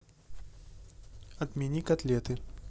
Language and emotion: Russian, neutral